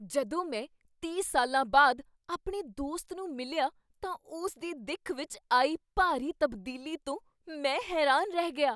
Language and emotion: Punjabi, surprised